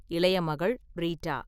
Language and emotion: Tamil, neutral